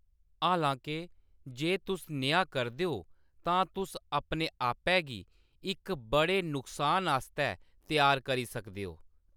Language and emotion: Dogri, neutral